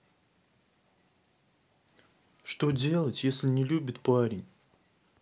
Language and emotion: Russian, sad